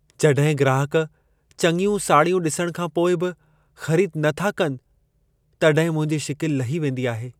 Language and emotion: Sindhi, sad